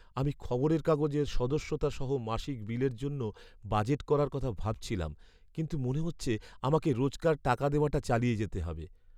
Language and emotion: Bengali, sad